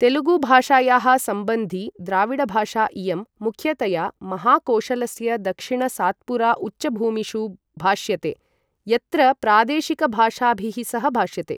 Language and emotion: Sanskrit, neutral